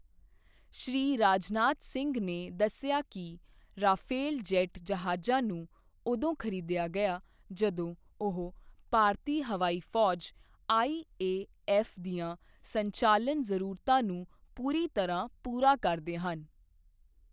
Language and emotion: Punjabi, neutral